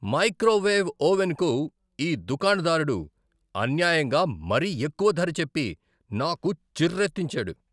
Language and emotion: Telugu, angry